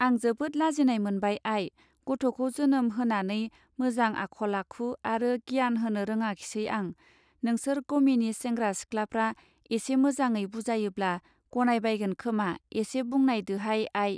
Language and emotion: Bodo, neutral